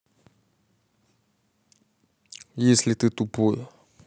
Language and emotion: Russian, neutral